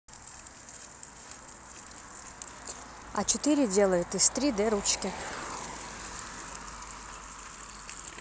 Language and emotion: Russian, neutral